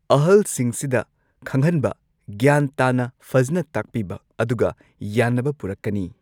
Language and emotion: Manipuri, neutral